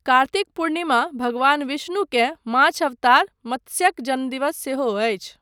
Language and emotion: Maithili, neutral